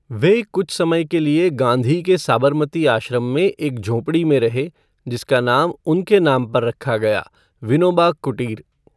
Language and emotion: Hindi, neutral